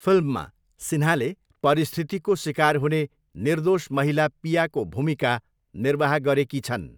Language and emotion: Nepali, neutral